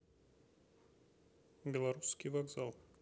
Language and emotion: Russian, neutral